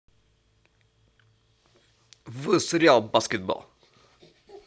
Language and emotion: Russian, neutral